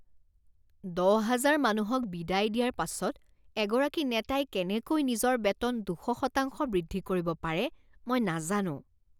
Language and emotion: Assamese, disgusted